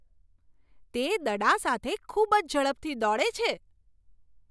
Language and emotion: Gujarati, surprised